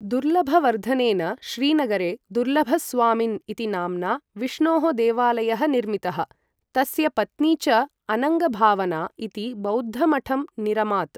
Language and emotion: Sanskrit, neutral